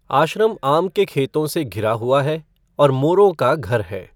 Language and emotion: Hindi, neutral